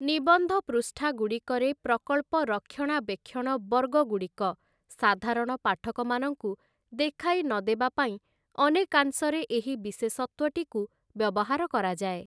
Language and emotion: Odia, neutral